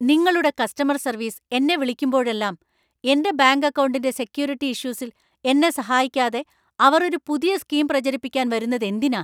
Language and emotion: Malayalam, angry